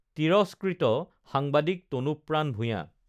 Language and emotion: Assamese, neutral